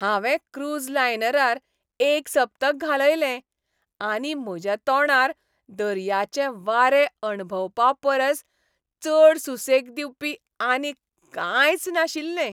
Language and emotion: Goan Konkani, happy